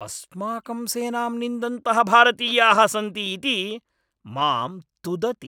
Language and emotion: Sanskrit, angry